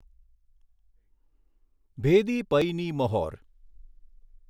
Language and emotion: Gujarati, neutral